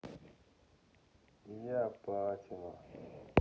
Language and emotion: Russian, sad